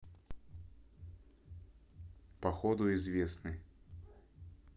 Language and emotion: Russian, neutral